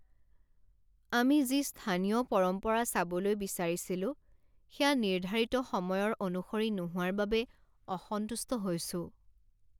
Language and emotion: Assamese, sad